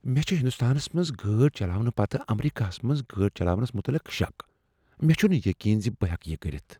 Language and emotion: Kashmiri, fearful